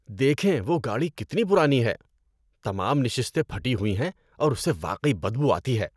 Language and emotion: Urdu, disgusted